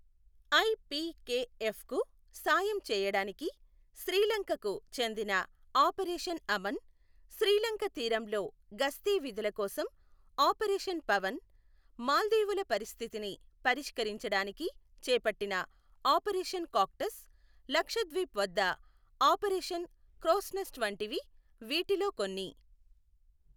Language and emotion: Telugu, neutral